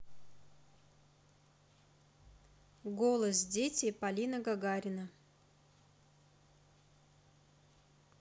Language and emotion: Russian, neutral